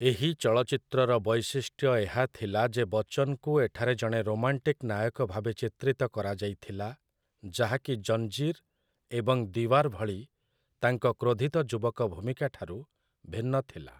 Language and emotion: Odia, neutral